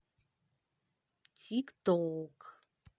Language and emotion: Russian, positive